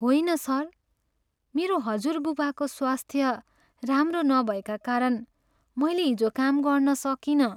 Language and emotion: Nepali, sad